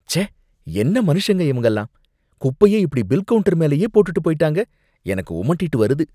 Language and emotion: Tamil, disgusted